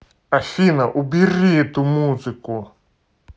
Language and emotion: Russian, angry